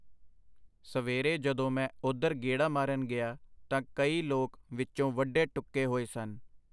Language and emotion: Punjabi, neutral